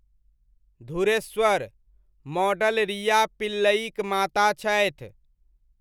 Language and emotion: Maithili, neutral